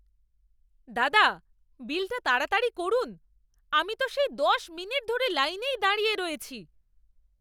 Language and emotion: Bengali, angry